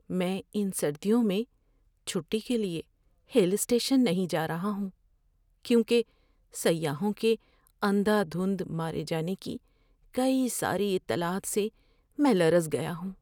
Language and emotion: Urdu, fearful